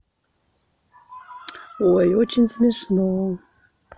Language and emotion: Russian, positive